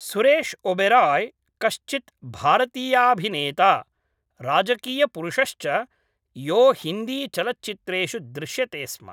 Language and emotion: Sanskrit, neutral